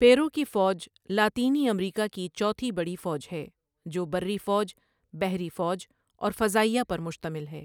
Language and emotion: Urdu, neutral